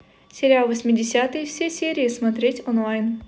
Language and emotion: Russian, neutral